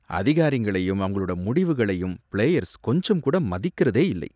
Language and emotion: Tamil, disgusted